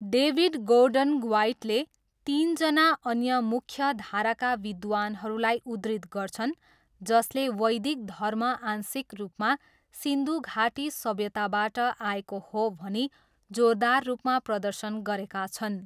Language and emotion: Nepali, neutral